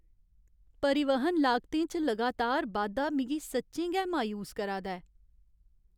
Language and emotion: Dogri, sad